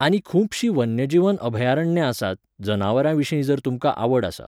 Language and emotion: Goan Konkani, neutral